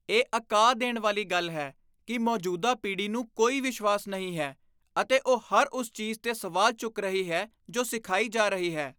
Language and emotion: Punjabi, disgusted